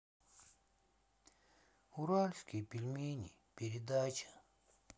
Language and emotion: Russian, sad